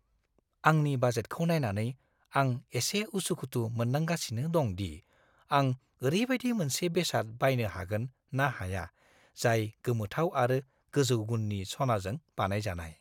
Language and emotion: Bodo, fearful